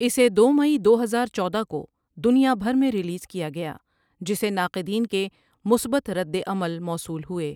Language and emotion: Urdu, neutral